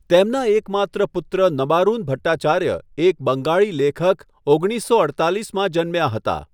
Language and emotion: Gujarati, neutral